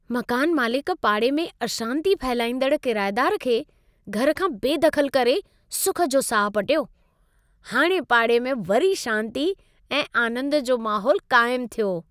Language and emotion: Sindhi, happy